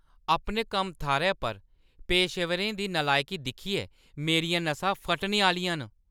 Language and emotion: Dogri, angry